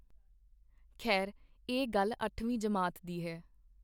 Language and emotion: Punjabi, neutral